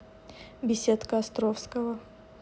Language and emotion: Russian, neutral